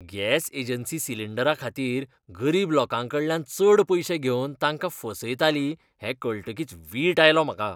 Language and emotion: Goan Konkani, disgusted